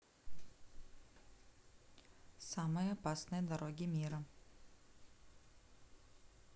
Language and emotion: Russian, neutral